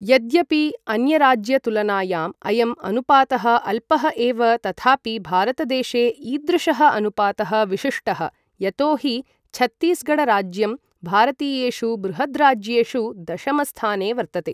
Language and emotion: Sanskrit, neutral